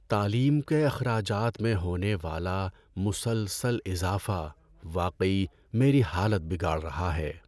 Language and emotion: Urdu, sad